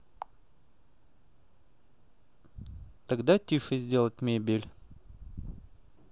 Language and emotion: Russian, neutral